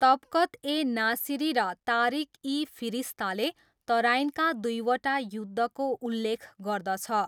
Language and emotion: Nepali, neutral